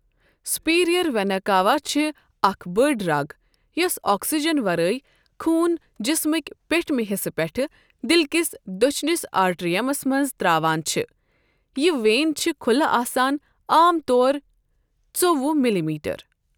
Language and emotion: Kashmiri, neutral